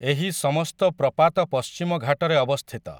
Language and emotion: Odia, neutral